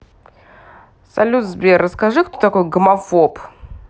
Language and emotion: Russian, neutral